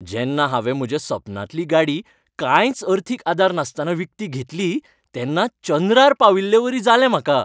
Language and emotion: Goan Konkani, happy